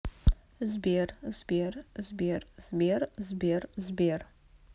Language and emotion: Russian, neutral